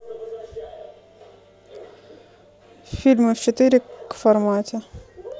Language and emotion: Russian, neutral